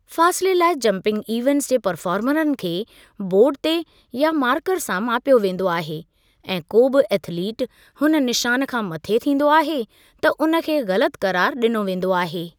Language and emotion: Sindhi, neutral